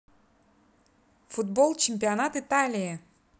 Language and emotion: Russian, positive